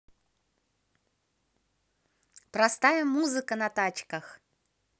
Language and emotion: Russian, positive